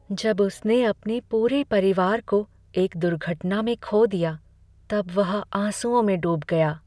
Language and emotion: Hindi, sad